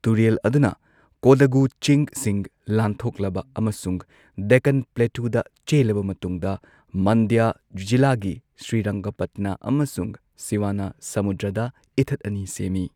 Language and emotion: Manipuri, neutral